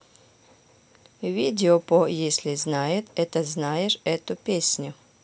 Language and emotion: Russian, neutral